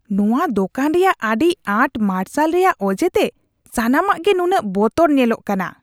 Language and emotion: Santali, disgusted